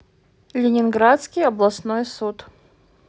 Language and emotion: Russian, neutral